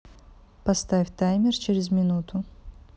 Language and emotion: Russian, neutral